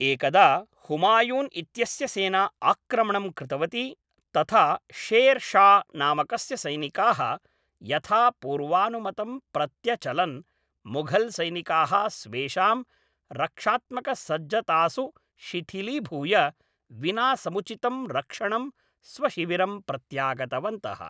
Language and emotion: Sanskrit, neutral